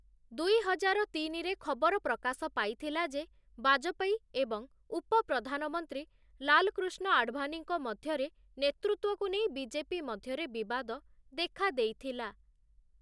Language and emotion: Odia, neutral